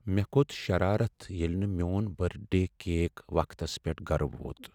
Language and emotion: Kashmiri, sad